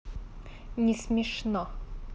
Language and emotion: Russian, angry